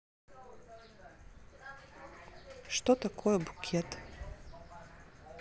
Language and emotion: Russian, neutral